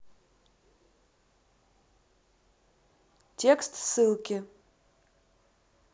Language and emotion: Russian, neutral